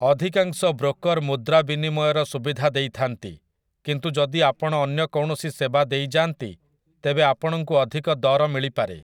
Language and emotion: Odia, neutral